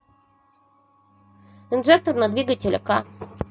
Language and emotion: Russian, neutral